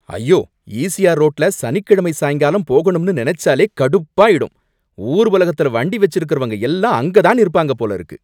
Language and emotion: Tamil, angry